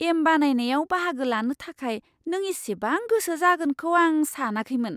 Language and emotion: Bodo, surprised